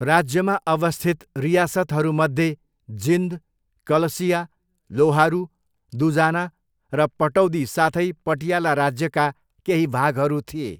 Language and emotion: Nepali, neutral